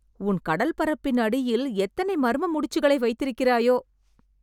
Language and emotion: Tamil, surprised